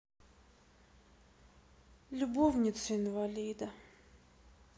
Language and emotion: Russian, sad